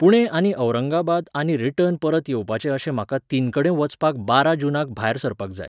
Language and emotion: Goan Konkani, neutral